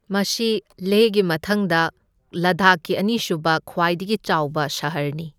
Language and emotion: Manipuri, neutral